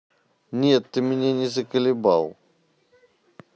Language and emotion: Russian, neutral